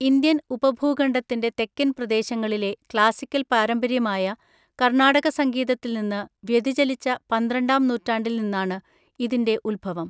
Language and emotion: Malayalam, neutral